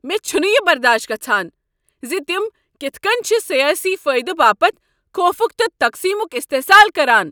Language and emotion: Kashmiri, angry